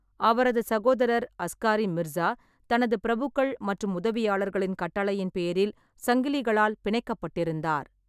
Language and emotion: Tamil, neutral